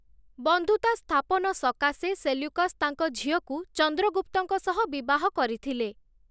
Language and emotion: Odia, neutral